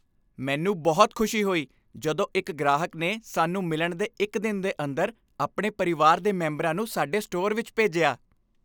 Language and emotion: Punjabi, happy